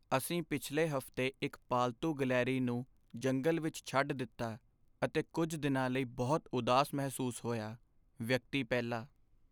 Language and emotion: Punjabi, sad